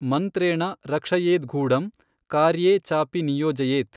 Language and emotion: Kannada, neutral